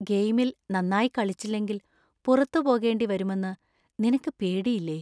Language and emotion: Malayalam, fearful